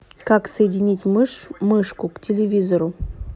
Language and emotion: Russian, neutral